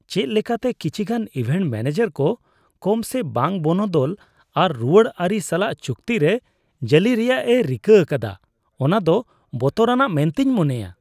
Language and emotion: Santali, disgusted